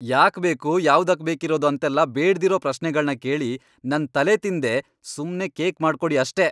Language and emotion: Kannada, angry